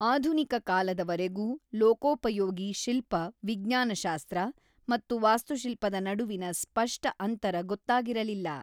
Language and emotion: Kannada, neutral